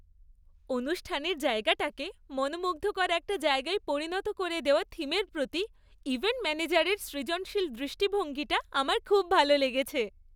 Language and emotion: Bengali, happy